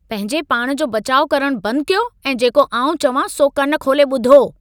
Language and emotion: Sindhi, angry